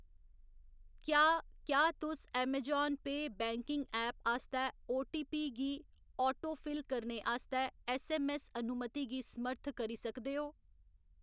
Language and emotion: Dogri, neutral